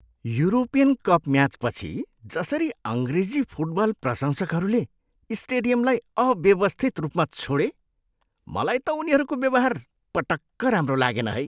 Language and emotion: Nepali, disgusted